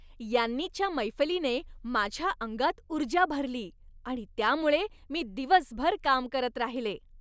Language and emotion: Marathi, happy